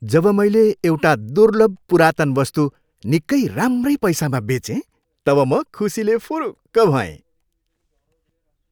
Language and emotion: Nepali, happy